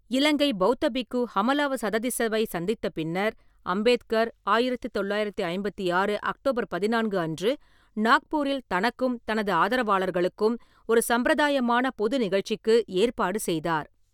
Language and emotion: Tamil, neutral